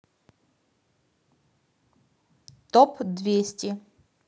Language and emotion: Russian, neutral